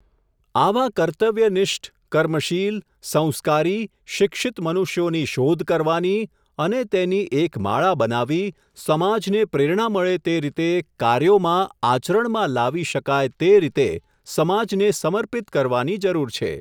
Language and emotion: Gujarati, neutral